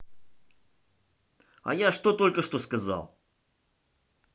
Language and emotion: Russian, angry